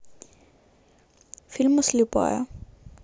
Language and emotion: Russian, neutral